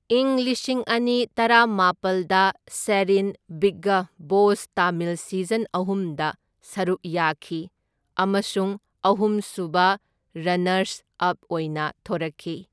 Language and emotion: Manipuri, neutral